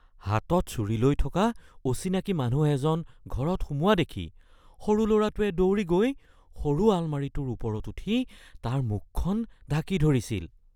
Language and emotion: Assamese, fearful